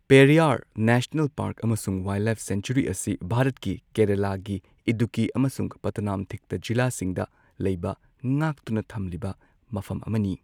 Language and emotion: Manipuri, neutral